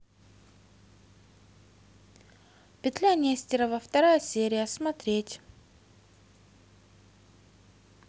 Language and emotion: Russian, positive